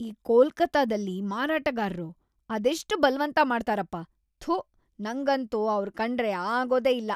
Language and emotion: Kannada, disgusted